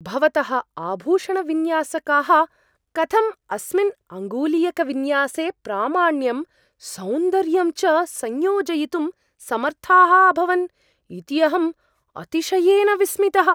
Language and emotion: Sanskrit, surprised